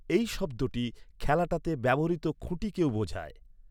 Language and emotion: Bengali, neutral